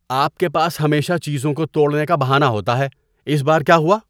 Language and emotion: Urdu, disgusted